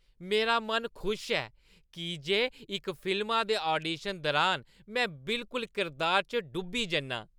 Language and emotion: Dogri, happy